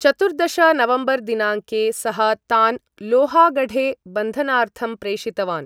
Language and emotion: Sanskrit, neutral